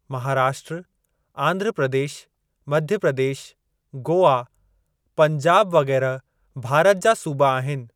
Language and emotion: Sindhi, neutral